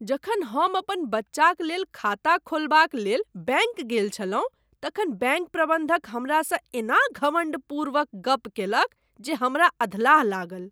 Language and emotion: Maithili, disgusted